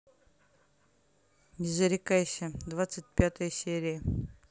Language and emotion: Russian, neutral